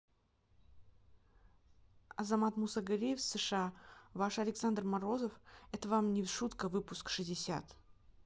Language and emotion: Russian, neutral